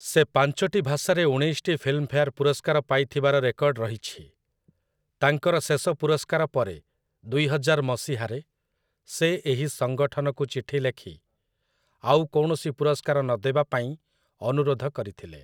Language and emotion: Odia, neutral